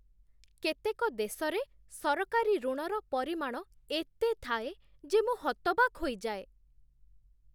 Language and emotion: Odia, surprised